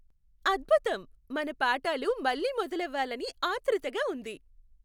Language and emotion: Telugu, happy